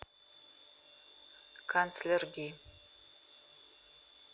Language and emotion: Russian, neutral